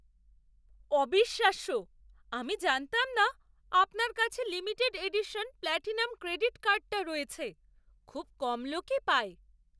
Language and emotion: Bengali, surprised